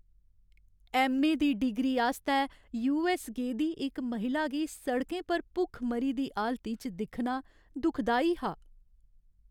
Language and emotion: Dogri, sad